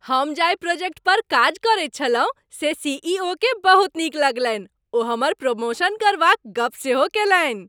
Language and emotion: Maithili, happy